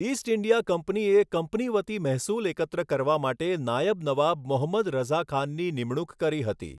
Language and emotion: Gujarati, neutral